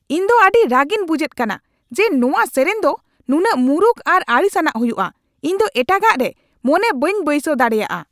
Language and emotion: Santali, angry